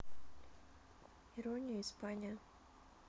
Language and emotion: Russian, neutral